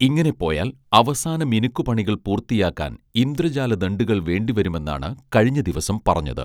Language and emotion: Malayalam, neutral